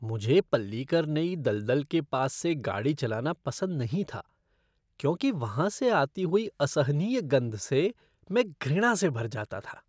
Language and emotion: Hindi, disgusted